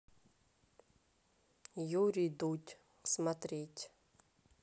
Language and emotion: Russian, neutral